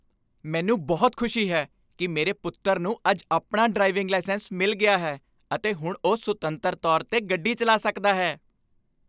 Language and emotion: Punjabi, happy